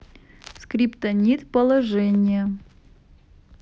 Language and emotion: Russian, neutral